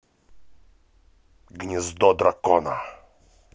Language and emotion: Russian, angry